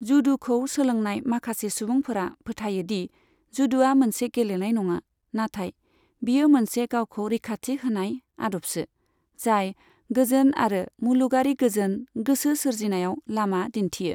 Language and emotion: Bodo, neutral